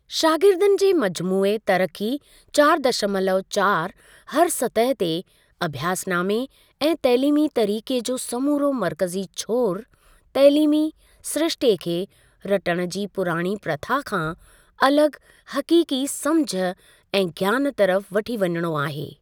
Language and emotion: Sindhi, neutral